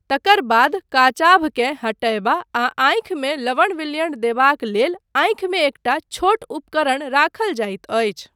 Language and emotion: Maithili, neutral